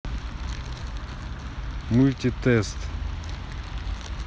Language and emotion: Russian, neutral